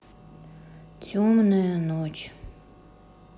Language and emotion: Russian, sad